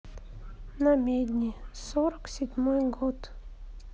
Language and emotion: Russian, sad